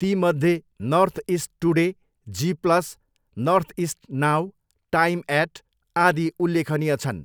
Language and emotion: Nepali, neutral